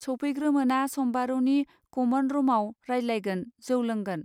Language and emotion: Bodo, neutral